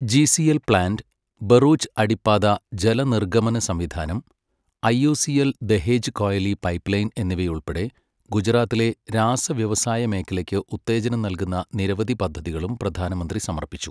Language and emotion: Malayalam, neutral